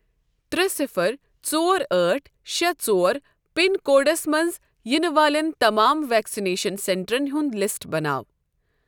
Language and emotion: Kashmiri, neutral